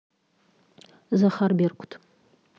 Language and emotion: Russian, neutral